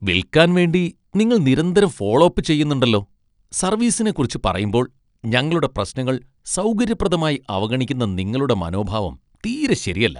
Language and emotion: Malayalam, disgusted